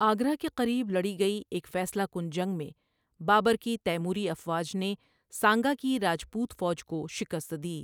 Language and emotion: Urdu, neutral